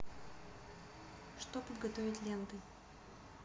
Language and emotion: Russian, neutral